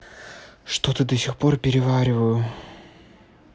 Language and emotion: Russian, sad